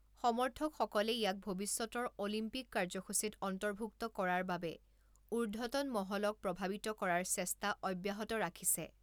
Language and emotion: Assamese, neutral